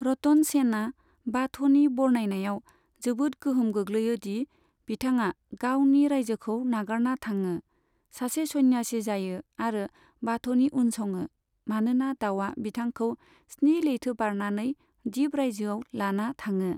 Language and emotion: Bodo, neutral